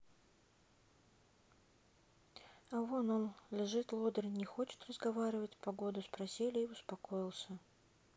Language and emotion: Russian, sad